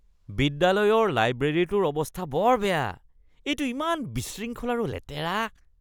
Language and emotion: Assamese, disgusted